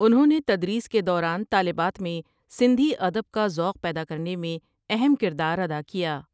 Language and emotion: Urdu, neutral